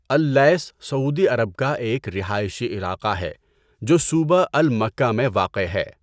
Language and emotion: Urdu, neutral